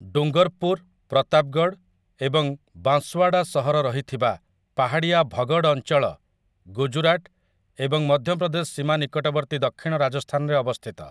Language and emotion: Odia, neutral